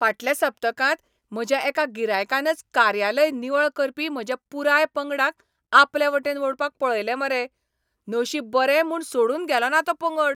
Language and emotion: Goan Konkani, angry